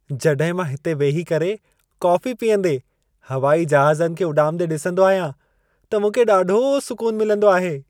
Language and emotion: Sindhi, happy